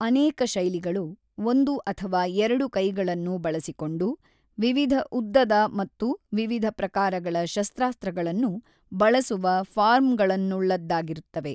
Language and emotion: Kannada, neutral